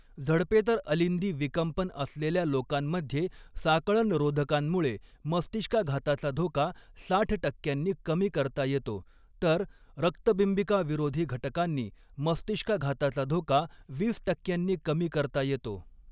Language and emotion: Marathi, neutral